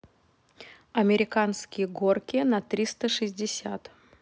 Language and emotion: Russian, neutral